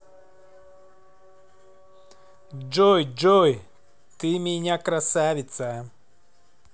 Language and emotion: Russian, positive